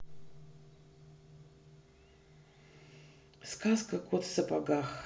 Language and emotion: Russian, sad